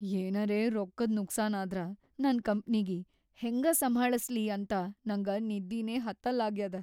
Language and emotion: Kannada, fearful